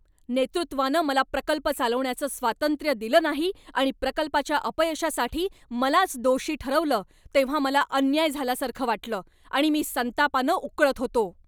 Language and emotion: Marathi, angry